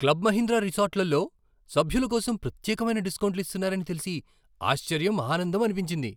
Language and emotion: Telugu, surprised